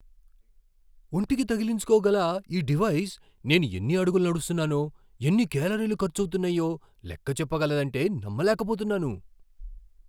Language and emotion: Telugu, surprised